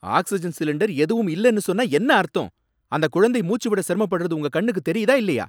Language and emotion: Tamil, angry